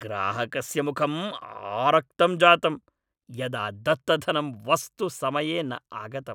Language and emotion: Sanskrit, angry